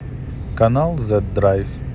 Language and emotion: Russian, neutral